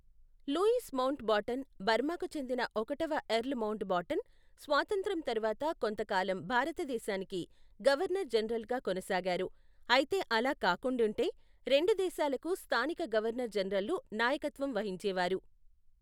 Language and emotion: Telugu, neutral